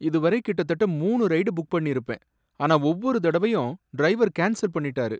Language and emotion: Tamil, sad